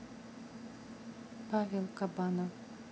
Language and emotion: Russian, sad